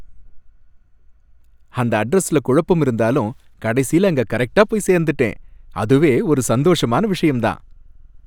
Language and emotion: Tamil, happy